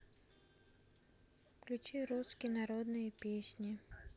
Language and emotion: Russian, sad